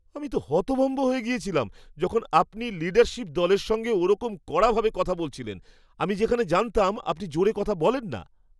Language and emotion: Bengali, surprised